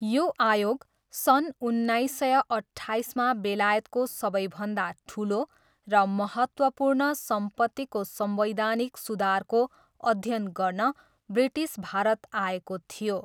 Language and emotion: Nepali, neutral